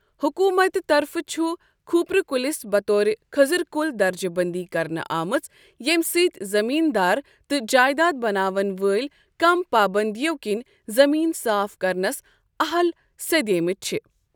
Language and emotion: Kashmiri, neutral